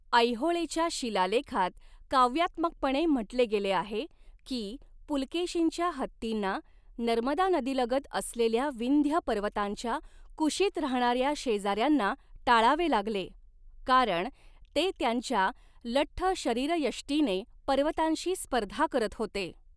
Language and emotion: Marathi, neutral